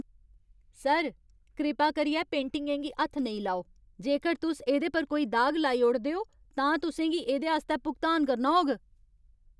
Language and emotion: Dogri, angry